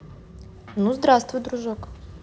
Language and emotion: Russian, neutral